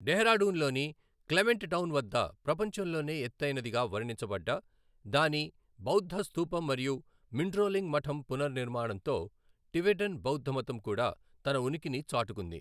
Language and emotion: Telugu, neutral